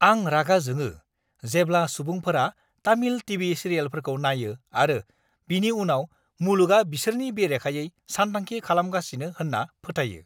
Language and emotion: Bodo, angry